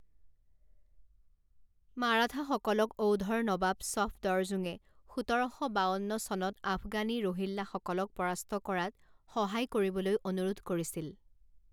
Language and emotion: Assamese, neutral